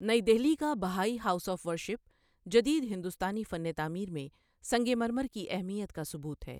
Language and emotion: Urdu, neutral